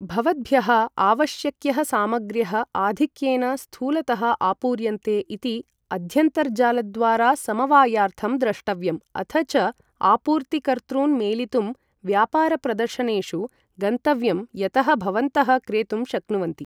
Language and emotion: Sanskrit, neutral